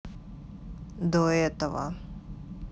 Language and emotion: Russian, neutral